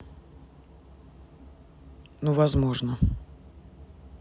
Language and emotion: Russian, neutral